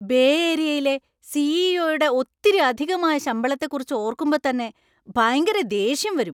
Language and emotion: Malayalam, angry